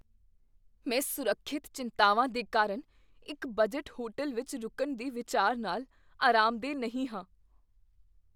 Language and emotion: Punjabi, fearful